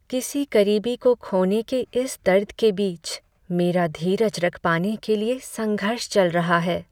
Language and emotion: Hindi, sad